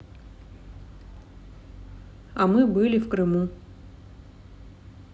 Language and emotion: Russian, neutral